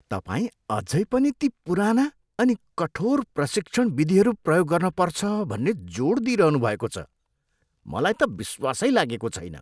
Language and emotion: Nepali, disgusted